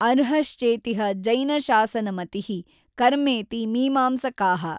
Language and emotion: Kannada, neutral